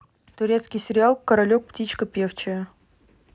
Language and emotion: Russian, neutral